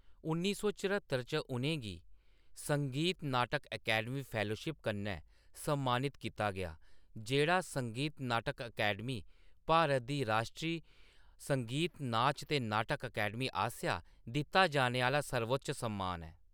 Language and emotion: Dogri, neutral